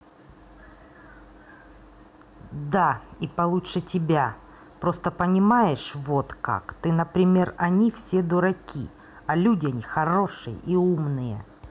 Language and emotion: Russian, angry